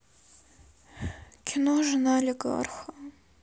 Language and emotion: Russian, sad